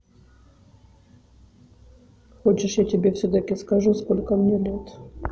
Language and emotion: Russian, neutral